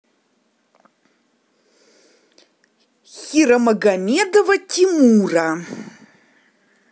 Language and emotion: Russian, angry